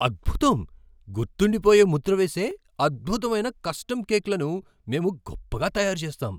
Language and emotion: Telugu, surprised